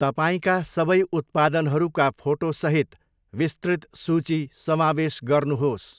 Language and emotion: Nepali, neutral